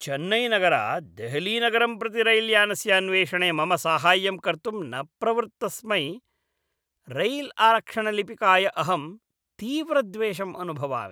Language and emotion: Sanskrit, disgusted